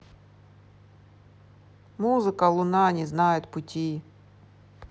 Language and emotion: Russian, neutral